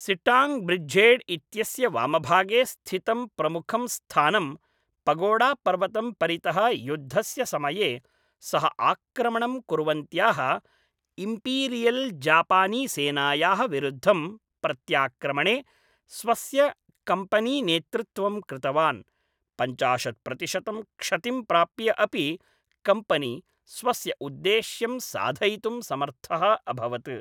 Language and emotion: Sanskrit, neutral